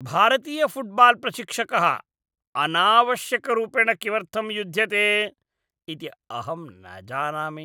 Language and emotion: Sanskrit, disgusted